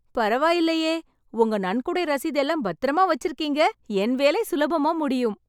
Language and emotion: Tamil, happy